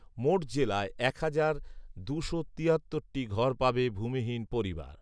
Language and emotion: Bengali, neutral